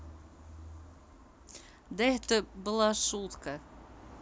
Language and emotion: Russian, positive